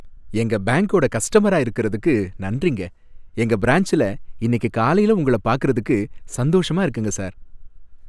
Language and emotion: Tamil, happy